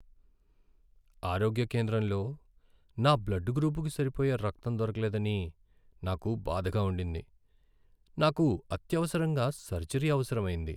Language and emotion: Telugu, sad